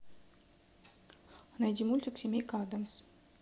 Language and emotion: Russian, neutral